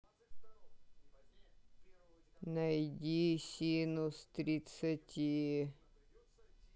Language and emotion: Russian, sad